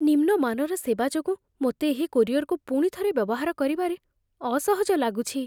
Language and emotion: Odia, fearful